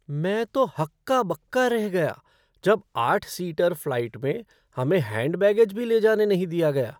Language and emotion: Hindi, surprised